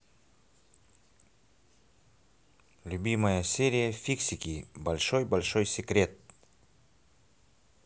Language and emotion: Russian, positive